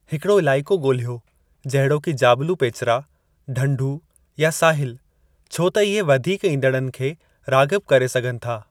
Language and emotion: Sindhi, neutral